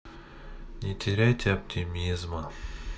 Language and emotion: Russian, sad